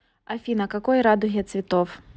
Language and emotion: Russian, neutral